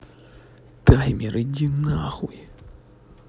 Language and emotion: Russian, angry